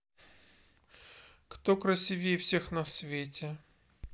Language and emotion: Russian, neutral